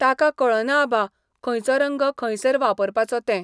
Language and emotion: Goan Konkani, neutral